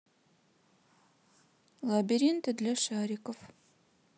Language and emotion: Russian, neutral